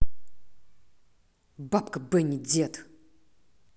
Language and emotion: Russian, angry